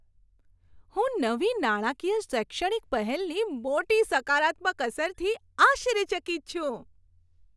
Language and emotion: Gujarati, surprised